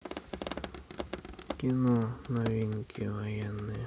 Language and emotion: Russian, neutral